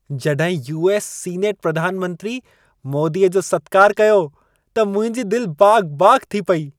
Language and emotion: Sindhi, happy